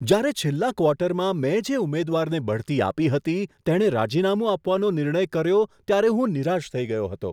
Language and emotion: Gujarati, surprised